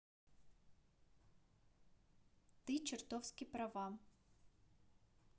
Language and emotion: Russian, neutral